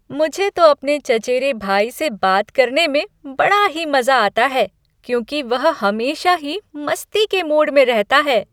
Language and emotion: Hindi, happy